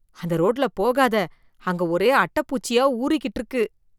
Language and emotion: Tamil, disgusted